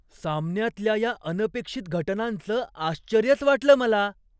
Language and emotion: Marathi, surprised